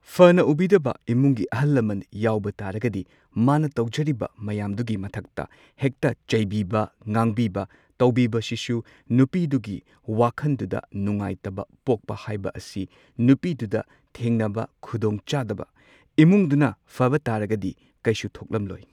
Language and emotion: Manipuri, neutral